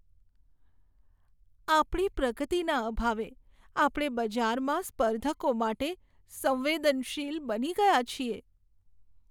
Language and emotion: Gujarati, sad